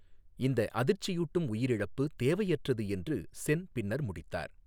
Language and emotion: Tamil, neutral